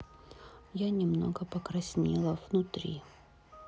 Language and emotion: Russian, sad